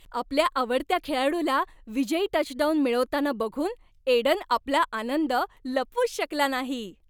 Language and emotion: Marathi, happy